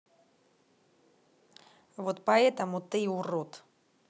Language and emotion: Russian, angry